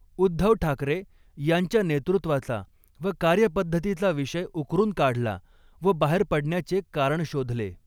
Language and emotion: Marathi, neutral